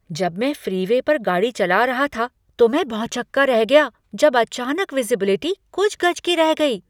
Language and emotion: Hindi, surprised